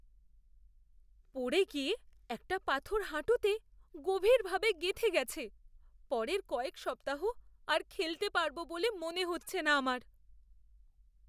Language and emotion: Bengali, fearful